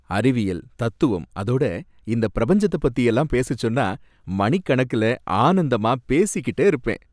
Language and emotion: Tamil, happy